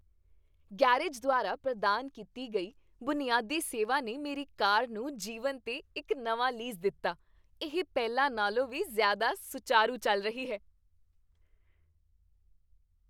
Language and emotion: Punjabi, happy